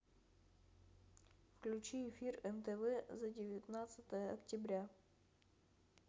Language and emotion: Russian, neutral